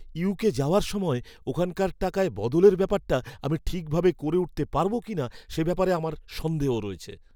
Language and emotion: Bengali, fearful